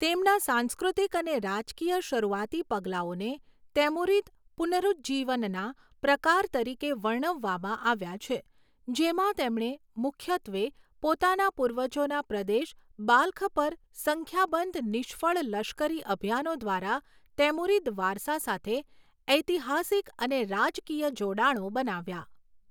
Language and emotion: Gujarati, neutral